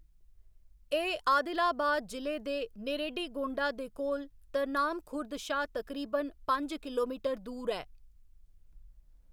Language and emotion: Dogri, neutral